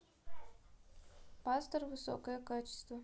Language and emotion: Russian, neutral